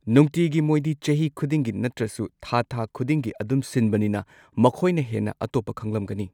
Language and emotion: Manipuri, neutral